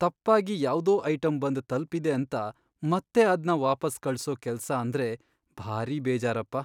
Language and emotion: Kannada, sad